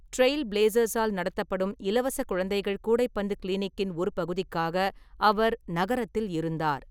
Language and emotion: Tamil, neutral